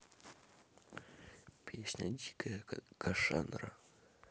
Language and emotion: Russian, neutral